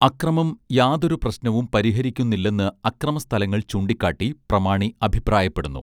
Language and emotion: Malayalam, neutral